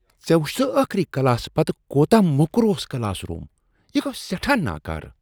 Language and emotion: Kashmiri, disgusted